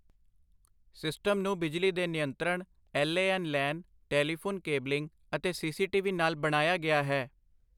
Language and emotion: Punjabi, neutral